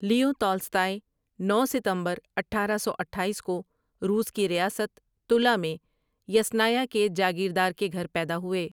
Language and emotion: Urdu, neutral